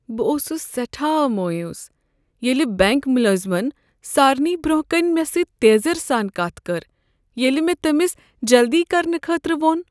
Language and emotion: Kashmiri, sad